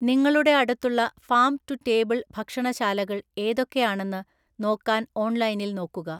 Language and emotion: Malayalam, neutral